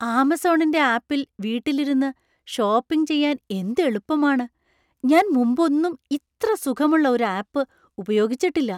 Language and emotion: Malayalam, surprised